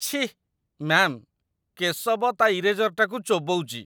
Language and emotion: Odia, disgusted